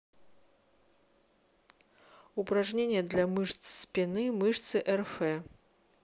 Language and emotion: Russian, neutral